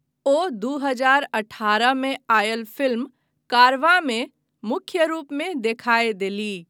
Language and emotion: Maithili, neutral